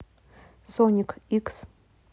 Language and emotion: Russian, neutral